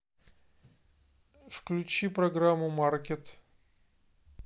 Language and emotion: Russian, neutral